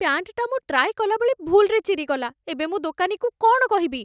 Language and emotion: Odia, fearful